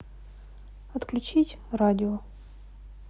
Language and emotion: Russian, neutral